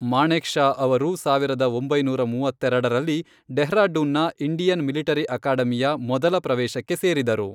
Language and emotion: Kannada, neutral